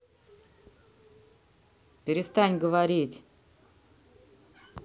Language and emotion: Russian, angry